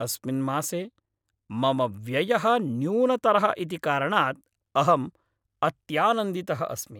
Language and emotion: Sanskrit, happy